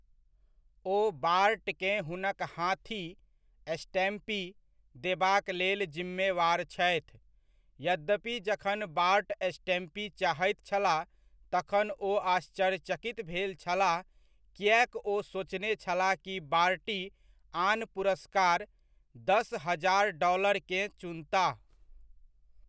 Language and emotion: Maithili, neutral